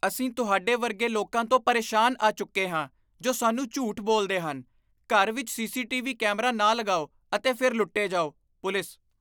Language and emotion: Punjabi, disgusted